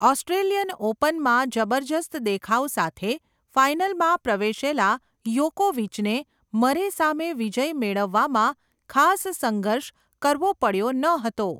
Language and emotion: Gujarati, neutral